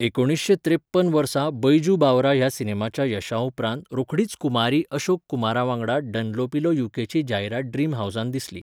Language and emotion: Goan Konkani, neutral